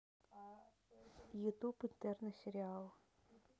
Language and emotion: Russian, neutral